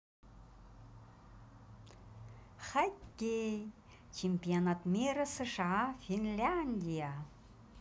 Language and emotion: Russian, positive